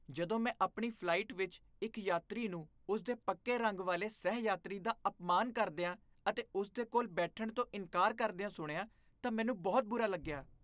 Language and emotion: Punjabi, disgusted